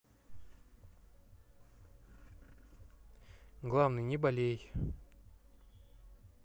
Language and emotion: Russian, neutral